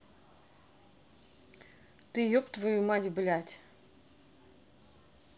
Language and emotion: Russian, angry